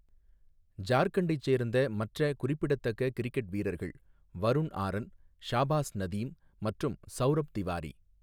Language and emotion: Tamil, neutral